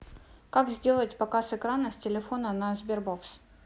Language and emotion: Russian, neutral